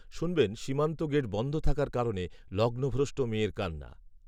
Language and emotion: Bengali, neutral